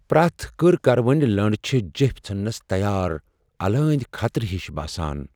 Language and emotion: Kashmiri, fearful